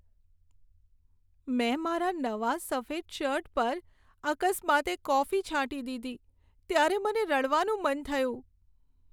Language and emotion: Gujarati, sad